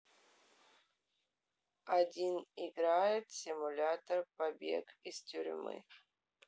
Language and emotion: Russian, neutral